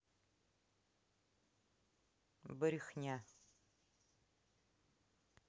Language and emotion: Russian, neutral